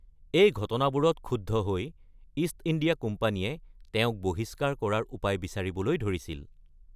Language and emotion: Assamese, neutral